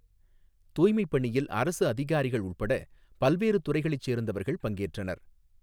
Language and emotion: Tamil, neutral